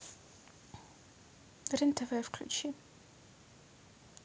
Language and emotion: Russian, neutral